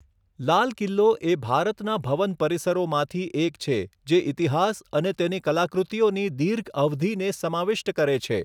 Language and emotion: Gujarati, neutral